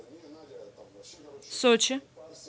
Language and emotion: Russian, neutral